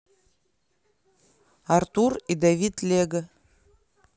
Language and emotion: Russian, neutral